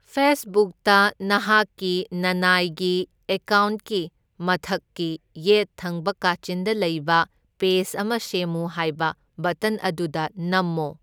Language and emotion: Manipuri, neutral